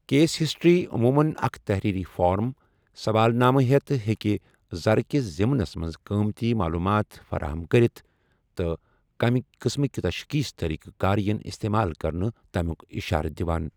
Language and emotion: Kashmiri, neutral